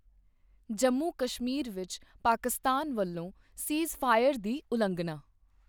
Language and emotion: Punjabi, neutral